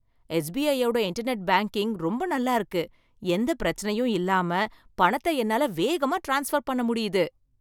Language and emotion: Tamil, happy